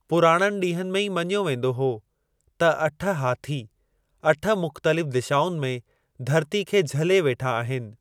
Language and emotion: Sindhi, neutral